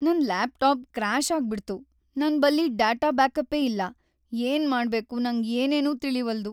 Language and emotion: Kannada, sad